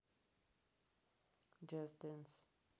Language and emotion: Russian, neutral